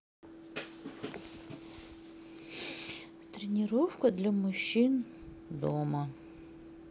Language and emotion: Russian, sad